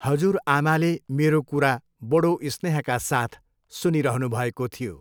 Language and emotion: Nepali, neutral